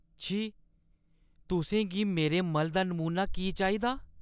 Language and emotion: Dogri, disgusted